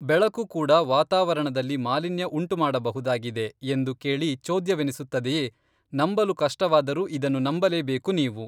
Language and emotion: Kannada, neutral